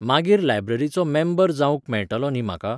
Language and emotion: Goan Konkani, neutral